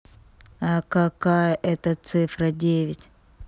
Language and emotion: Russian, neutral